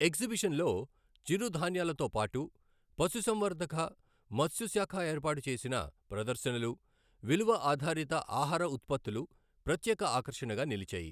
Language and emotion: Telugu, neutral